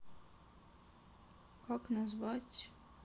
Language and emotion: Russian, sad